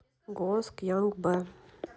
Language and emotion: Russian, neutral